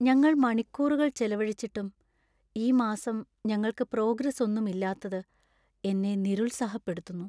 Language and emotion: Malayalam, sad